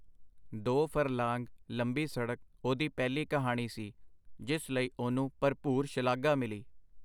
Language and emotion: Punjabi, neutral